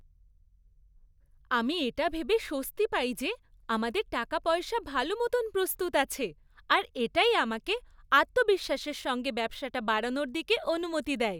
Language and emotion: Bengali, happy